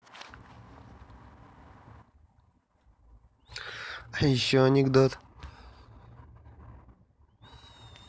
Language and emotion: Russian, neutral